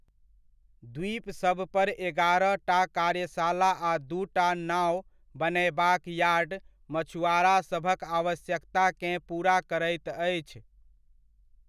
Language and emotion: Maithili, neutral